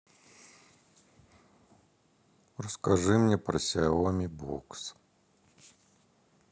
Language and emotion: Russian, neutral